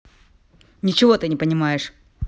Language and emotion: Russian, angry